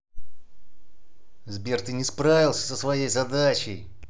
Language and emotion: Russian, angry